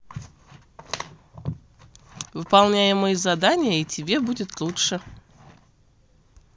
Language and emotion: Russian, neutral